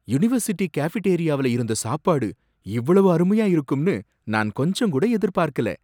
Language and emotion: Tamil, surprised